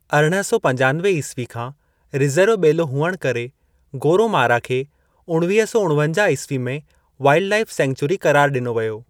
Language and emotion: Sindhi, neutral